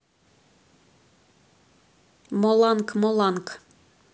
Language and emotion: Russian, neutral